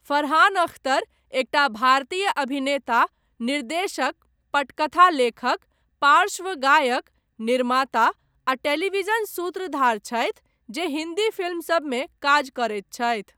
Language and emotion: Maithili, neutral